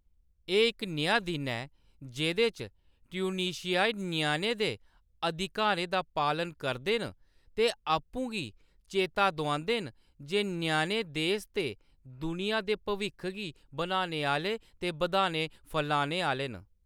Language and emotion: Dogri, neutral